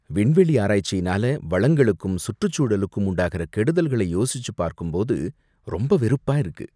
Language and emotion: Tamil, disgusted